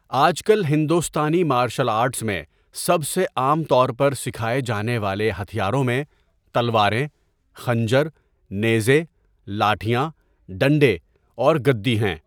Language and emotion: Urdu, neutral